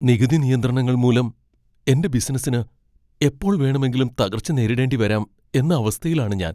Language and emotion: Malayalam, fearful